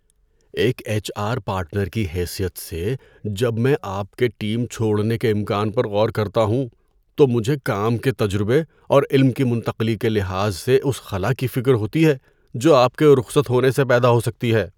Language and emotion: Urdu, fearful